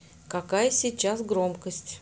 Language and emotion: Russian, neutral